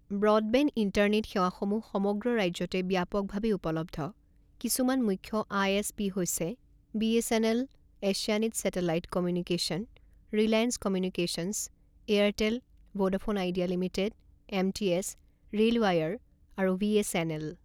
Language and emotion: Assamese, neutral